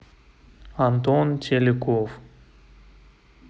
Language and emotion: Russian, neutral